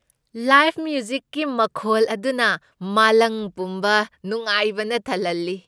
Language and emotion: Manipuri, happy